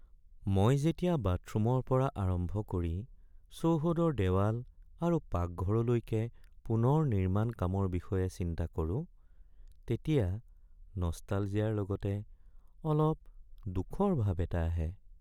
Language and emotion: Assamese, sad